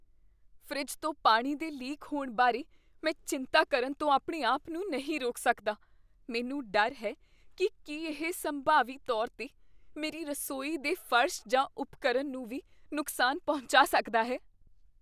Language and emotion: Punjabi, fearful